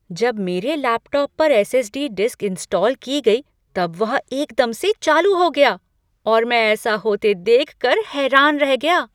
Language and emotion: Hindi, surprised